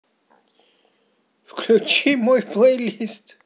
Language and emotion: Russian, positive